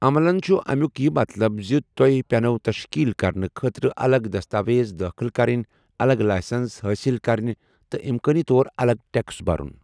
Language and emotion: Kashmiri, neutral